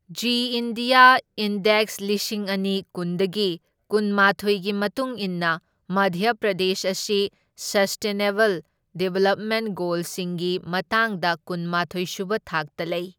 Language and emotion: Manipuri, neutral